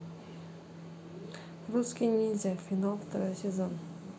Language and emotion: Russian, neutral